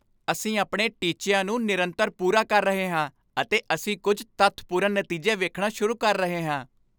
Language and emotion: Punjabi, happy